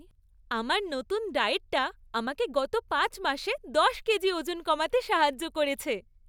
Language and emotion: Bengali, happy